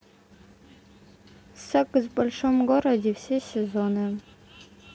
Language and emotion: Russian, neutral